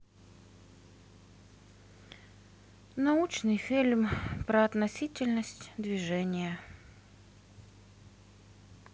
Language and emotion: Russian, sad